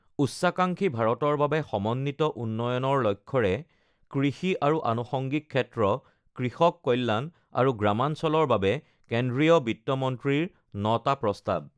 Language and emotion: Assamese, neutral